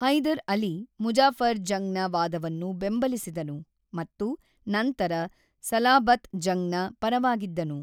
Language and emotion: Kannada, neutral